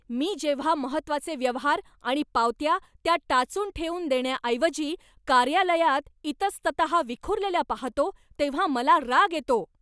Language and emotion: Marathi, angry